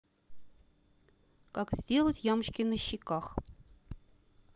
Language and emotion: Russian, neutral